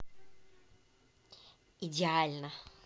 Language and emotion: Russian, positive